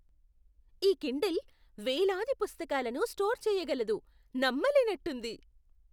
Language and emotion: Telugu, surprised